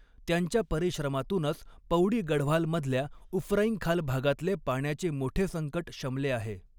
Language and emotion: Marathi, neutral